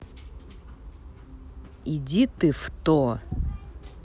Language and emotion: Russian, angry